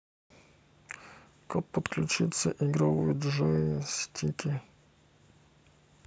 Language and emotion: Russian, neutral